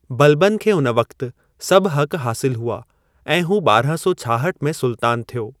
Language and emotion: Sindhi, neutral